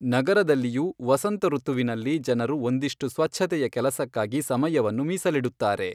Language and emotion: Kannada, neutral